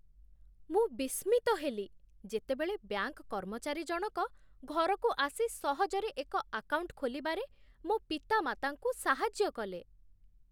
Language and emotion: Odia, surprised